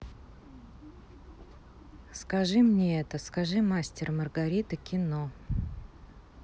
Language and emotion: Russian, neutral